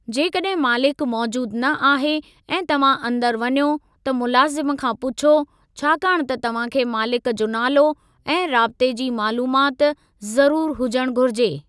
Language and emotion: Sindhi, neutral